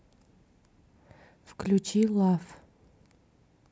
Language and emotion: Russian, neutral